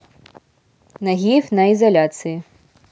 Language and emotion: Russian, neutral